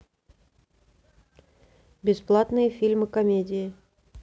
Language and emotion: Russian, neutral